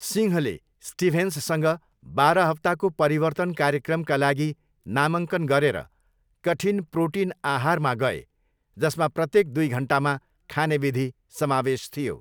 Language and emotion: Nepali, neutral